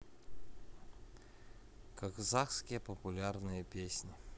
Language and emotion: Russian, neutral